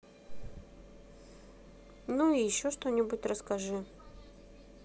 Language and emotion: Russian, neutral